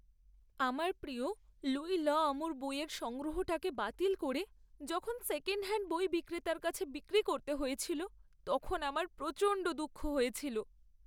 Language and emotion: Bengali, sad